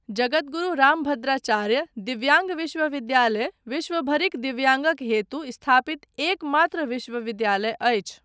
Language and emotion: Maithili, neutral